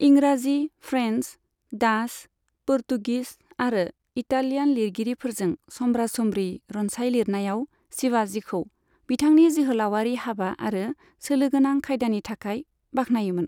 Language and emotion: Bodo, neutral